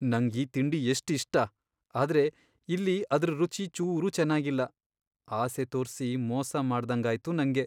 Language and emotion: Kannada, sad